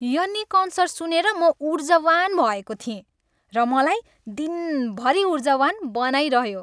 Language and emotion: Nepali, happy